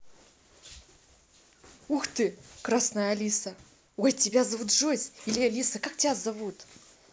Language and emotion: Russian, positive